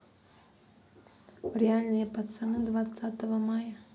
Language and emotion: Russian, neutral